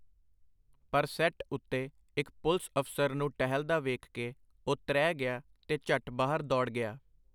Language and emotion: Punjabi, neutral